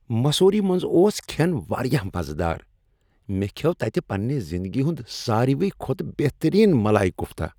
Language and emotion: Kashmiri, happy